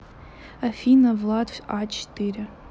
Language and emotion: Russian, neutral